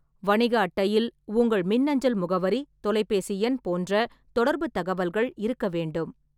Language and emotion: Tamil, neutral